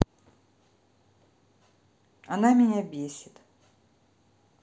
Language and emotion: Russian, neutral